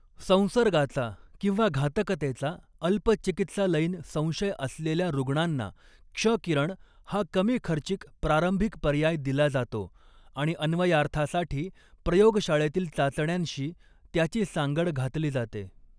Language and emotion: Marathi, neutral